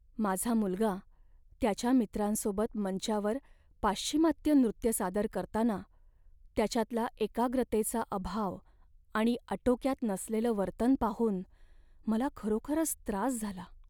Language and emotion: Marathi, sad